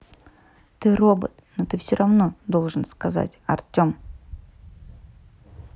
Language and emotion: Russian, neutral